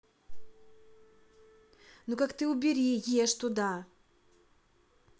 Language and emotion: Russian, angry